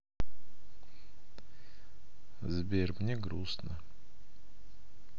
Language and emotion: Russian, sad